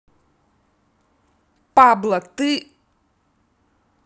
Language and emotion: Russian, angry